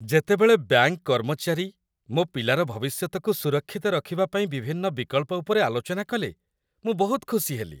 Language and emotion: Odia, happy